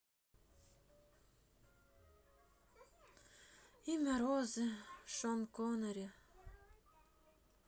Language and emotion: Russian, sad